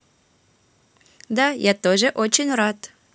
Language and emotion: Russian, positive